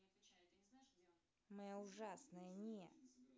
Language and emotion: Russian, angry